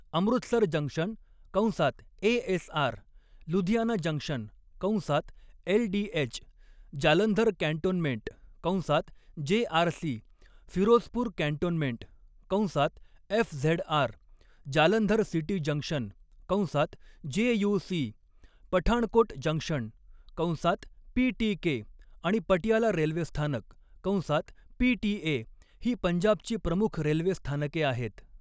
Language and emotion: Marathi, neutral